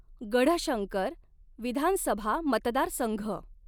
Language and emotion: Marathi, neutral